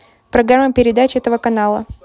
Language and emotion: Russian, neutral